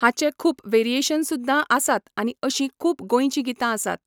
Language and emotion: Goan Konkani, neutral